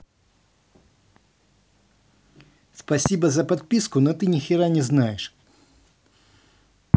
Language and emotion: Russian, angry